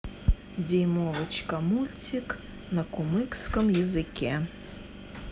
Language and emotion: Russian, neutral